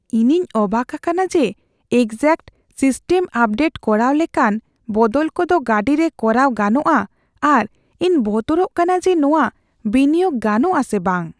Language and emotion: Santali, fearful